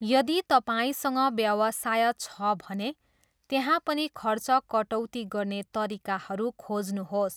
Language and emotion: Nepali, neutral